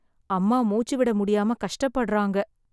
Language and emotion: Tamil, sad